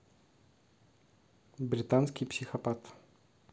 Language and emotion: Russian, neutral